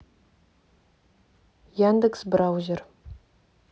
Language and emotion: Russian, neutral